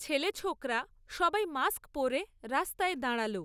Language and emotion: Bengali, neutral